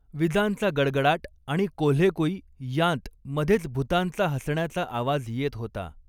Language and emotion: Marathi, neutral